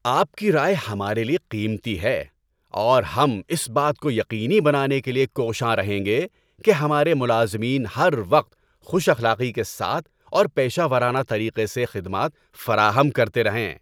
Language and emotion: Urdu, happy